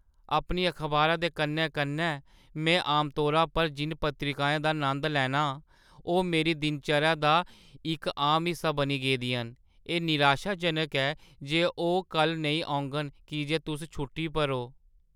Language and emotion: Dogri, sad